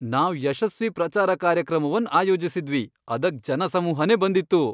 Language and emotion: Kannada, happy